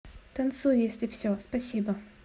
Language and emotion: Russian, positive